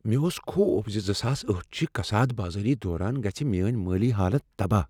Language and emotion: Kashmiri, fearful